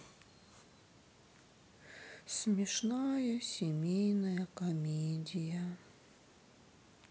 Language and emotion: Russian, sad